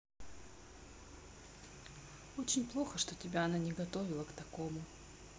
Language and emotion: Russian, sad